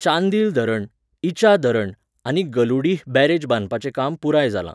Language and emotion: Goan Konkani, neutral